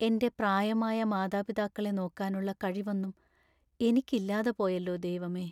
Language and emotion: Malayalam, sad